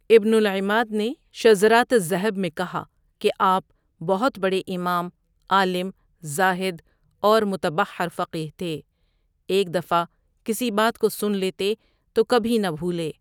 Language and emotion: Urdu, neutral